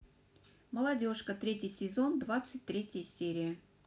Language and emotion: Russian, neutral